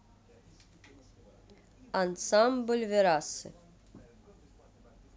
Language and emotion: Russian, neutral